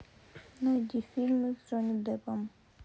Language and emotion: Russian, sad